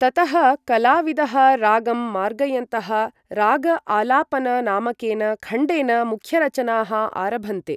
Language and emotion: Sanskrit, neutral